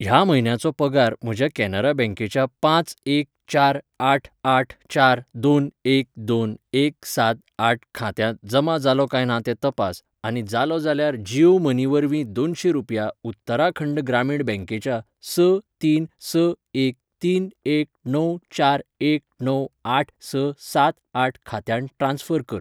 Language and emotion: Goan Konkani, neutral